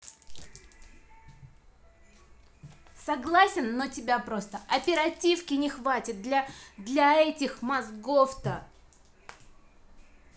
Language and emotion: Russian, angry